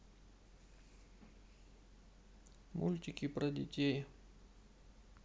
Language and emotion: Russian, sad